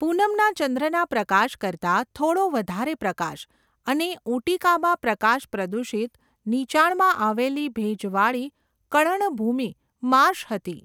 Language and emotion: Gujarati, neutral